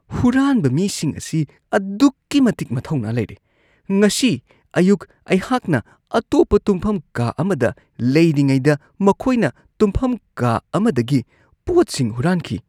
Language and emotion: Manipuri, disgusted